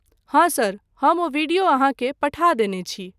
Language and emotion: Maithili, neutral